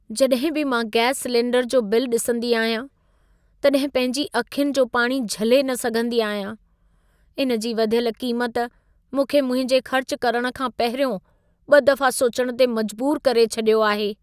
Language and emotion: Sindhi, sad